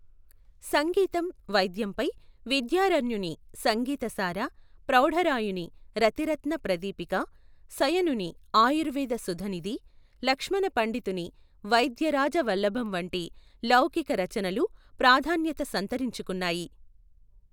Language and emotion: Telugu, neutral